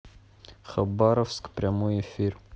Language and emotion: Russian, neutral